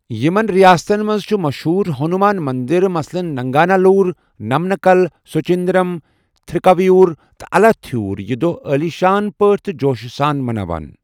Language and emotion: Kashmiri, neutral